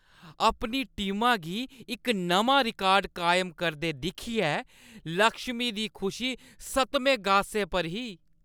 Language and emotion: Dogri, happy